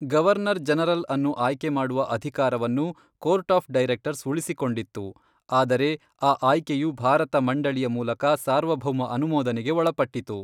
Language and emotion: Kannada, neutral